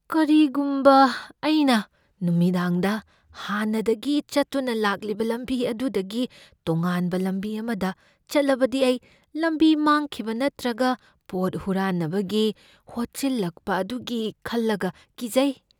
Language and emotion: Manipuri, fearful